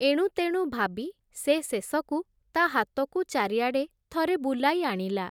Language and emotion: Odia, neutral